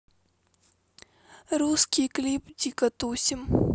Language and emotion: Russian, sad